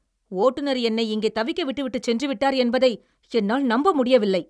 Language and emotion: Tamil, angry